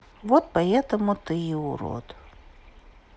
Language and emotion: Russian, neutral